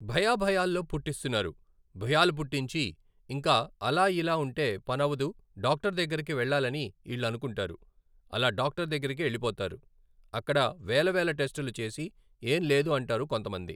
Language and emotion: Telugu, neutral